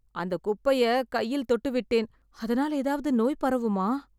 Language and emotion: Tamil, fearful